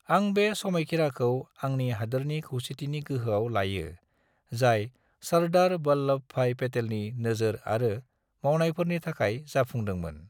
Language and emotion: Bodo, neutral